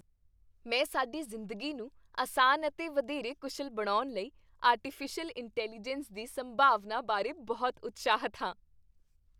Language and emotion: Punjabi, happy